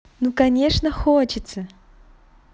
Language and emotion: Russian, positive